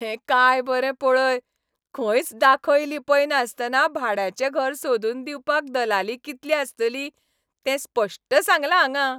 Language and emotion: Goan Konkani, happy